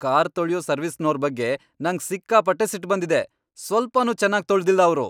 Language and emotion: Kannada, angry